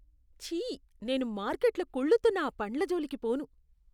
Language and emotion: Telugu, disgusted